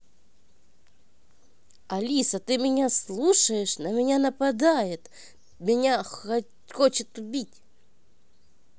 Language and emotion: Russian, neutral